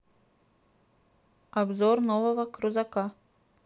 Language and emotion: Russian, neutral